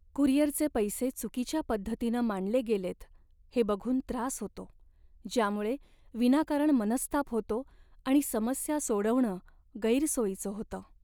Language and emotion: Marathi, sad